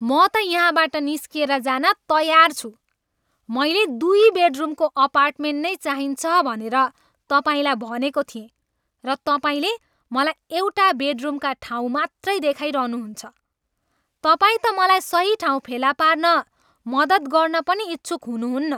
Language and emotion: Nepali, angry